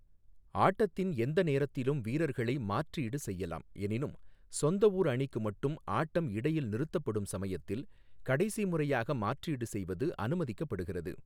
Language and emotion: Tamil, neutral